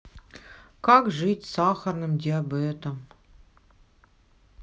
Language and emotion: Russian, sad